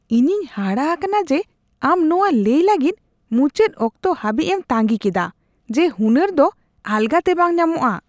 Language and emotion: Santali, disgusted